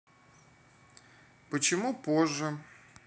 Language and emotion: Russian, neutral